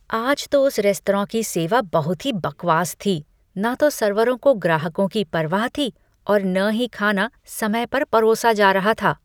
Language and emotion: Hindi, disgusted